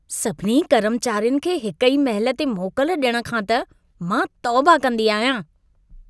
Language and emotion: Sindhi, disgusted